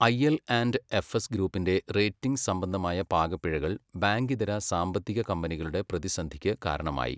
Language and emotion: Malayalam, neutral